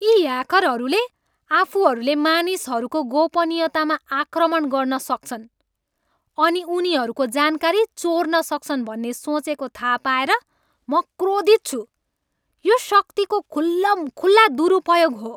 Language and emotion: Nepali, angry